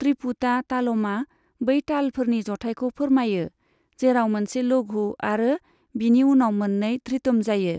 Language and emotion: Bodo, neutral